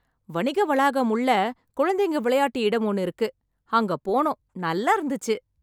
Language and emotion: Tamil, happy